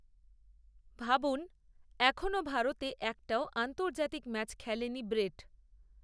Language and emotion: Bengali, neutral